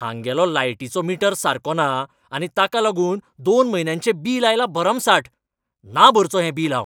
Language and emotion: Goan Konkani, angry